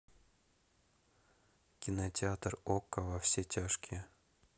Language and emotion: Russian, neutral